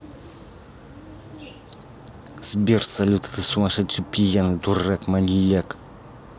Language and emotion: Russian, angry